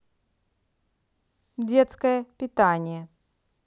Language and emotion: Russian, neutral